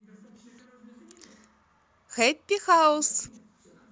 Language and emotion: Russian, positive